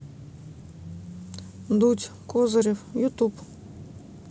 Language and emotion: Russian, neutral